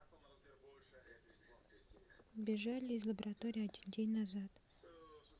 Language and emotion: Russian, neutral